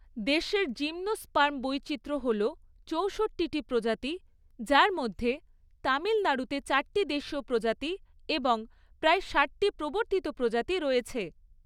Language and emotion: Bengali, neutral